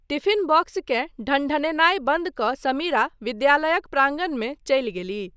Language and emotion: Maithili, neutral